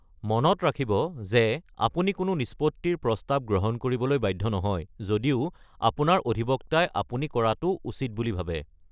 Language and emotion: Assamese, neutral